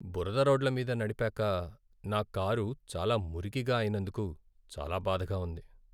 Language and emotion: Telugu, sad